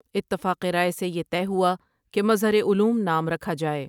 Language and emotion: Urdu, neutral